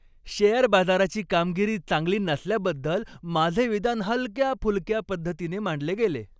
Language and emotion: Marathi, happy